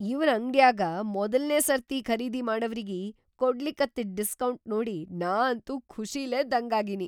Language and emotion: Kannada, surprised